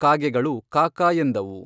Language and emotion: Kannada, neutral